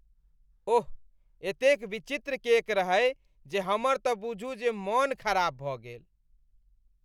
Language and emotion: Maithili, disgusted